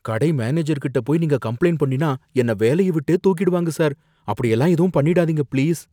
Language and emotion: Tamil, fearful